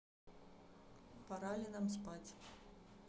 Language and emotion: Russian, neutral